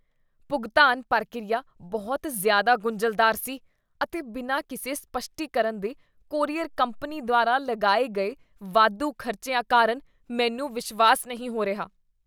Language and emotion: Punjabi, disgusted